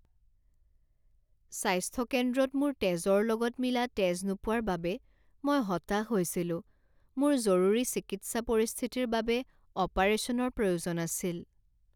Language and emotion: Assamese, sad